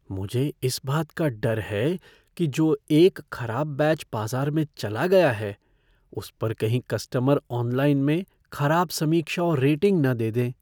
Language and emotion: Hindi, fearful